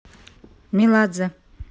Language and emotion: Russian, neutral